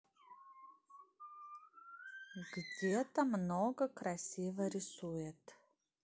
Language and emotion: Russian, neutral